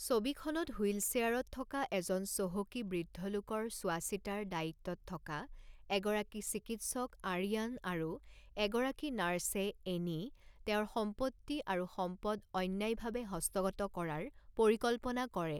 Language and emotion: Assamese, neutral